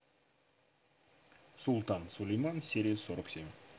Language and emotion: Russian, neutral